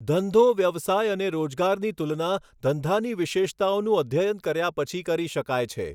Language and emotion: Gujarati, neutral